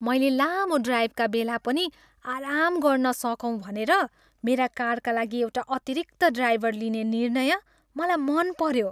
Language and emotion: Nepali, happy